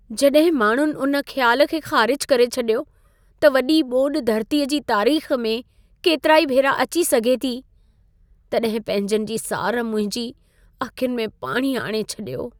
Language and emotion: Sindhi, sad